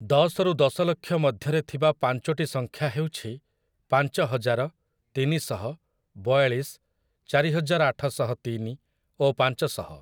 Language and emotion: Odia, neutral